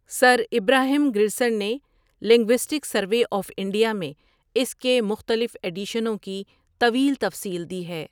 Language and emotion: Urdu, neutral